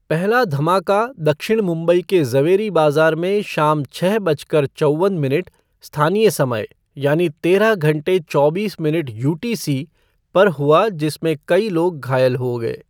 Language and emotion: Hindi, neutral